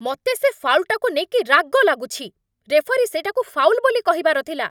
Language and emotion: Odia, angry